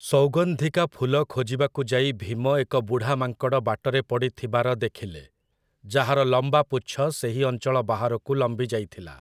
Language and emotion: Odia, neutral